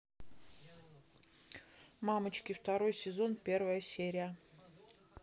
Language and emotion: Russian, neutral